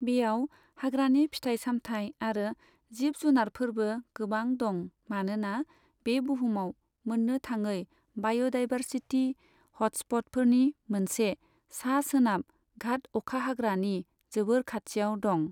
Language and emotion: Bodo, neutral